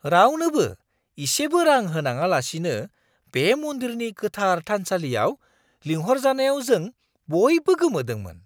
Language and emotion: Bodo, surprised